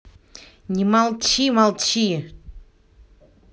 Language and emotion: Russian, angry